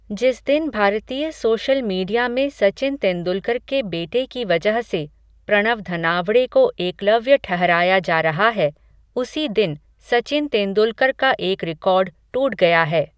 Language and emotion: Hindi, neutral